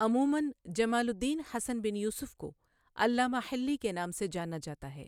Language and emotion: Urdu, neutral